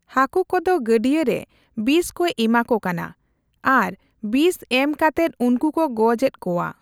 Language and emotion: Santali, neutral